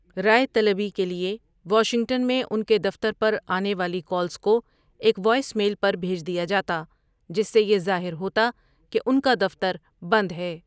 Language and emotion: Urdu, neutral